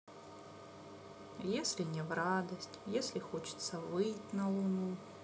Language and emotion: Russian, sad